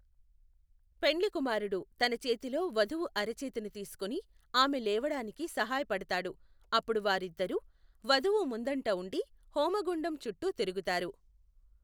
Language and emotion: Telugu, neutral